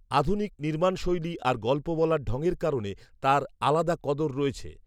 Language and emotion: Bengali, neutral